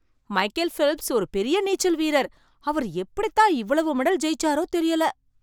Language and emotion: Tamil, surprised